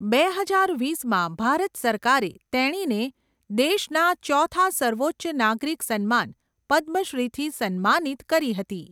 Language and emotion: Gujarati, neutral